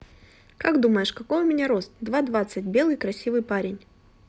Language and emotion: Russian, neutral